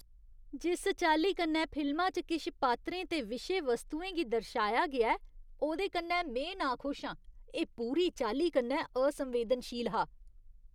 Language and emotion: Dogri, disgusted